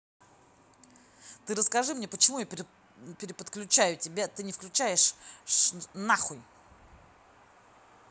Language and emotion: Russian, angry